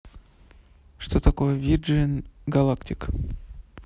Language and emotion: Russian, neutral